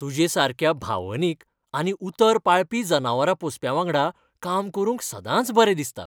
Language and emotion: Goan Konkani, happy